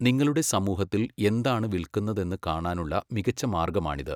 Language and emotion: Malayalam, neutral